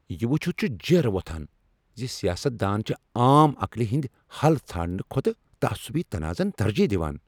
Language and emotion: Kashmiri, angry